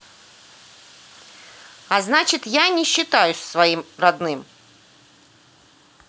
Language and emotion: Russian, angry